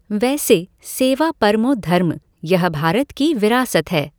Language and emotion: Hindi, neutral